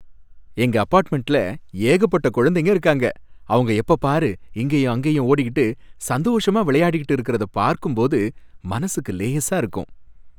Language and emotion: Tamil, happy